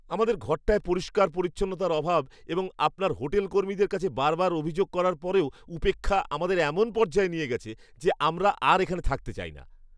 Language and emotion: Bengali, disgusted